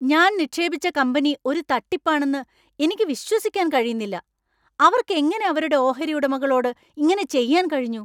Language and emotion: Malayalam, angry